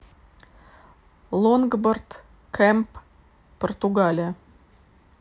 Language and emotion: Russian, neutral